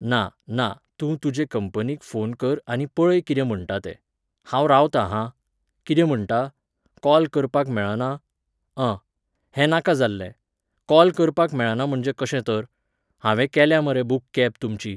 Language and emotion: Goan Konkani, neutral